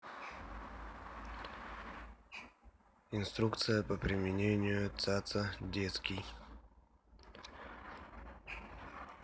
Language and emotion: Russian, neutral